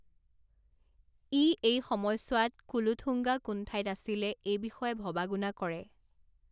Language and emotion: Assamese, neutral